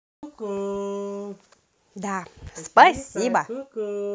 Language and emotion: Russian, positive